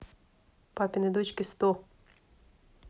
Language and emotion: Russian, neutral